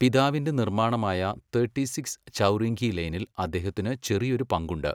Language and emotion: Malayalam, neutral